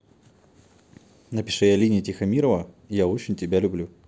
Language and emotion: Russian, neutral